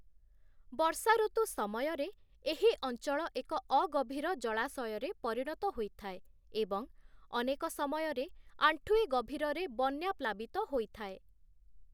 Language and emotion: Odia, neutral